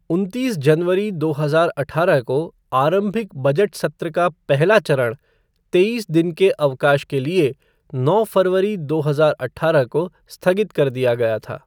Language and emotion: Hindi, neutral